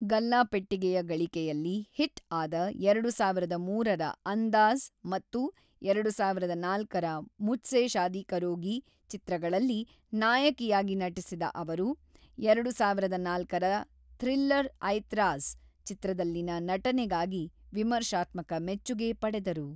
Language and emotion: Kannada, neutral